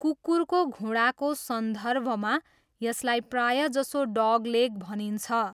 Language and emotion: Nepali, neutral